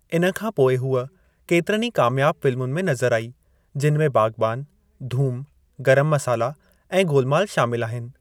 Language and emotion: Sindhi, neutral